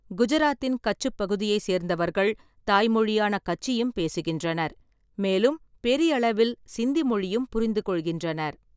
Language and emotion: Tamil, neutral